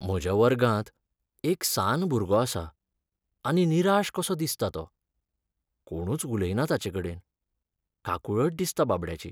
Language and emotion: Goan Konkani, sad